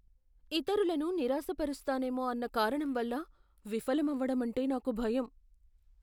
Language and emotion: Telugu, fearful